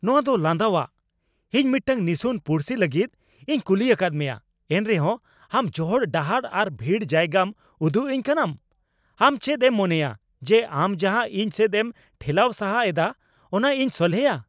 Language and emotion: Santali, angry